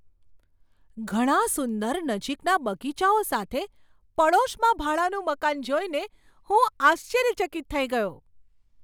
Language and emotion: Gujarati, surprised